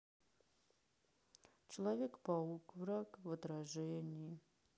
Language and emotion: Russian, sad